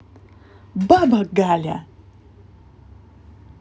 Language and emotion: Russian, angry